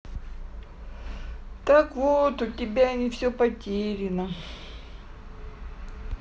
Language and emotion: Russian, sad